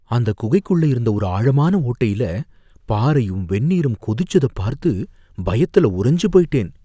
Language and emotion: Tamil, fearful